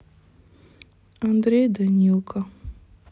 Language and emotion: Russian, sad